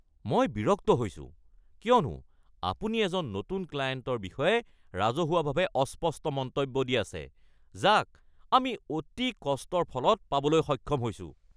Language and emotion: Assamese, angry